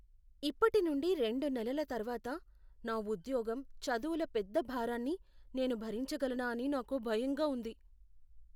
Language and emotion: Telugu, fearful